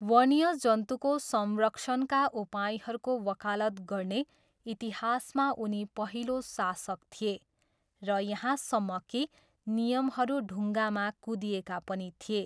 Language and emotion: Nepali, neutral